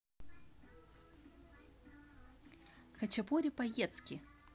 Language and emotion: Russian, positive